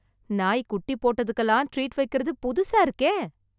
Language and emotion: Tamil, surprised